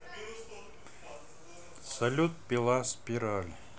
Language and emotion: Russian, neutral